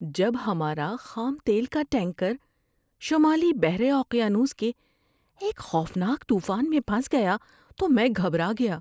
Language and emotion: Urdu, fearful